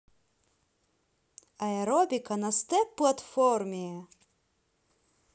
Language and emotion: Russian, positive